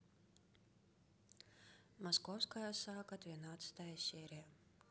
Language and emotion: Russian, neutral